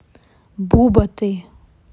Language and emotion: Russian, neutral